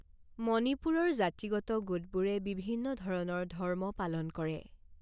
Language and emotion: Assamese, neutral